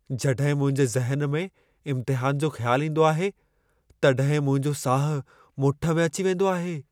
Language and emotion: Sindhi, fearful